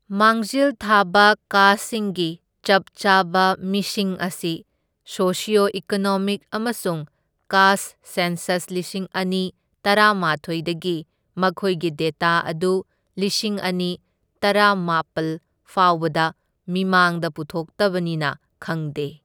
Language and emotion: Manipuri, neutral